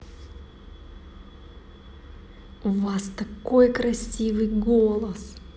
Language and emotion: Russian, positive